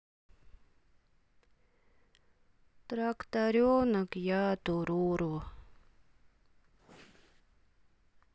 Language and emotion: Russian, sad